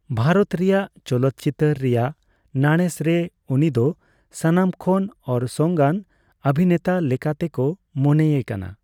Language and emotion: Santali, neutral